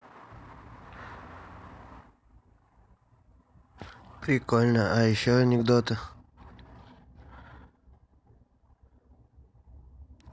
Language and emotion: Russian, neutral